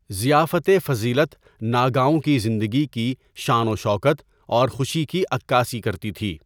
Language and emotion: Urdu, neutral